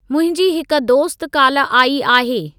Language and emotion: Sindhi, neutral